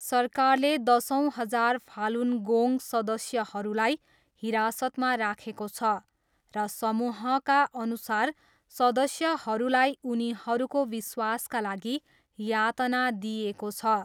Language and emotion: Nepali, neutral